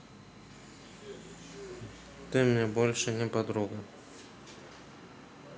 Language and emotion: Russian, sad